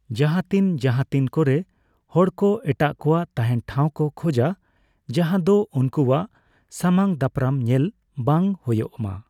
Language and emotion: Santali, neutral